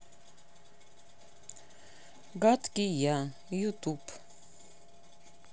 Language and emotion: Russian, neutral